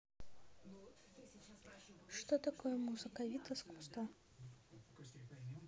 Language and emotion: Russian, neutral